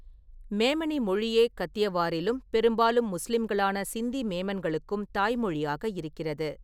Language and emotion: Tamil, neutral